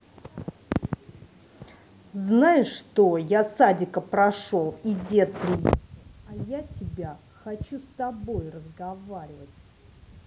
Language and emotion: Russian, angry